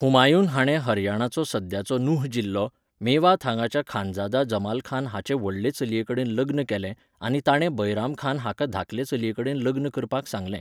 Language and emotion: Goan Konkani, neutral